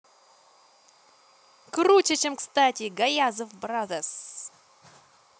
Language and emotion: Russian, positive